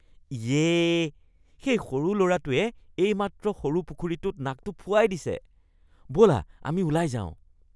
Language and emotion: Assamese, disgusted